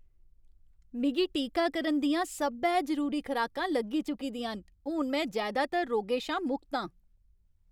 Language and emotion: Dogri, happy